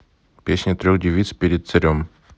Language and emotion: Russian, neutral